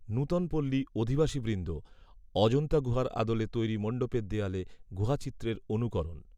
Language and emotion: Bengali, neutral